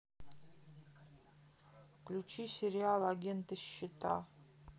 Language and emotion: Russian, neutral